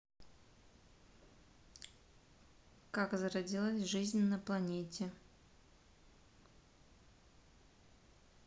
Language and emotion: Russian, neutral